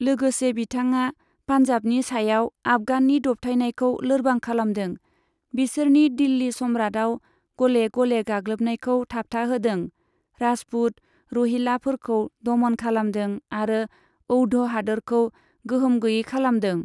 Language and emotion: Bodo, neutral